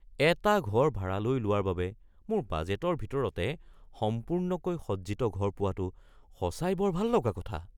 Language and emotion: Assamese, surprised